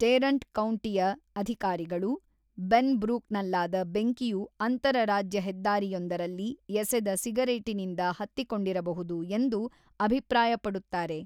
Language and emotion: Kannada, neutral